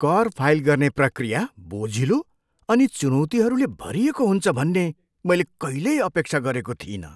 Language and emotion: Nepali, surprised